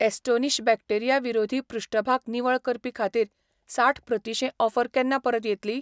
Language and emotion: Goan Konkani, neutral